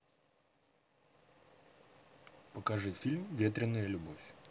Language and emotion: Russian, neutral